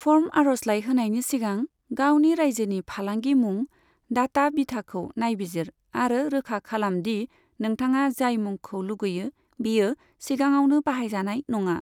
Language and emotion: Bodo, neutral